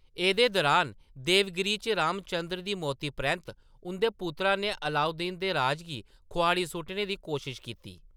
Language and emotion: Dogri, neutral